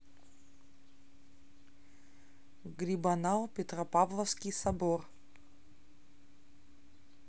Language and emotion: Russian, neutral